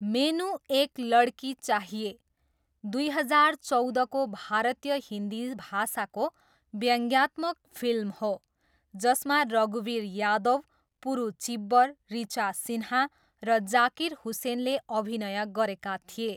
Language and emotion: Nepali, neutral